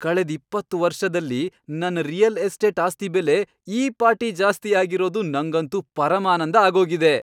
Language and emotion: Kannada, happy